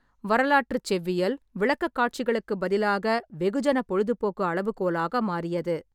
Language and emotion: Tamil, neutral